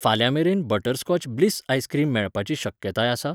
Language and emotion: Goan Konkani, neutral